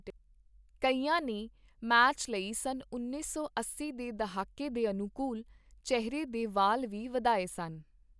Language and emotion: Punjabi, neutral